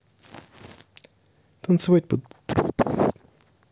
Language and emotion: Russian, neutral